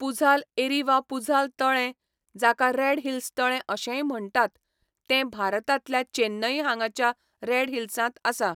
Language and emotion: Goan Konkani, neutral